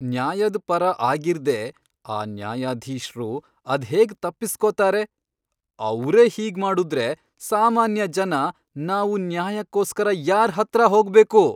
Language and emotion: Kannada, angry